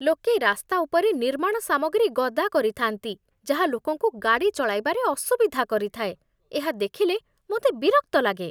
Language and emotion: Odia, disgusted